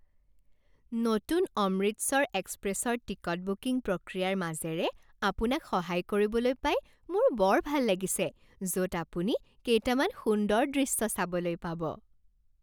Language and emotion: Assamese, happy